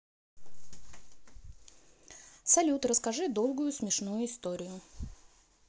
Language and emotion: Russian, neutral